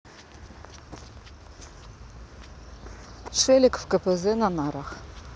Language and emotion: Russian, neutral